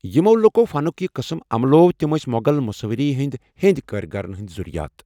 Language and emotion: Kashmiri, neutral